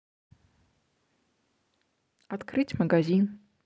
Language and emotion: Russian, neutral